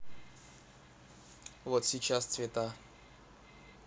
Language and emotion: Russian, neutral